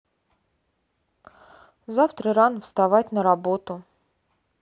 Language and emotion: Russian, sad